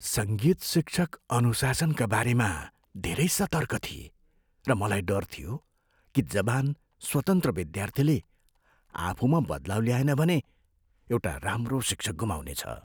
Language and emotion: Nepali, fearful